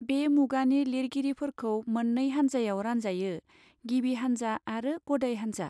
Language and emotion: Bodo, neutral